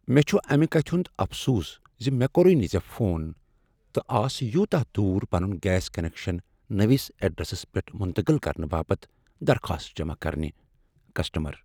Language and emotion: Kashmiri, sad